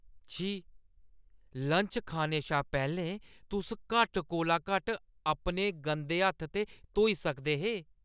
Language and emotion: Dogri, disgusted